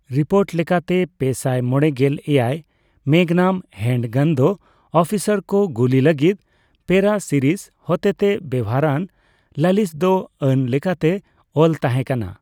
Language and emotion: Santali, neutral